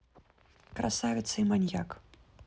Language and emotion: Russian, neutral